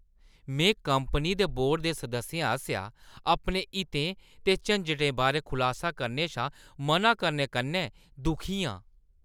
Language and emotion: Dogri, disgusted